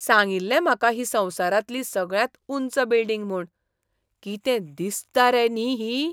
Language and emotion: Goan Konkani, surprised